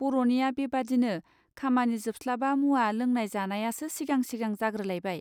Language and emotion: Bodo, neutral